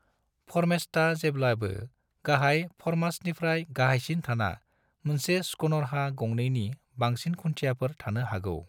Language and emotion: Bodo, neutral